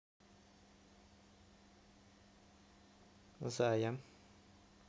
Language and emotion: Russian, neutral